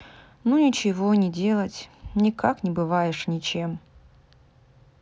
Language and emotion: Russian, sad